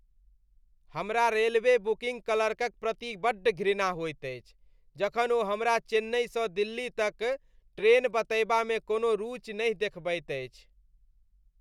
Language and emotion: Maithili, disgusted